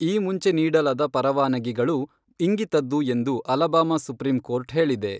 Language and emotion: Kannada, neutral